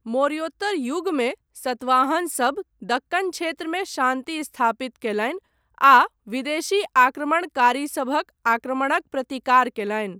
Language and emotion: Maithili, neutral